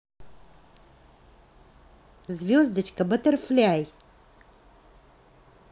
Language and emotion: Russian, positive